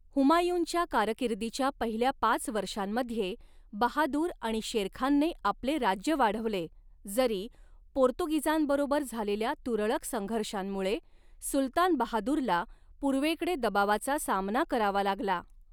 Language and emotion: Marathi, neutral